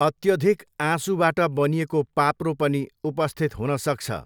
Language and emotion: Nepali, neutral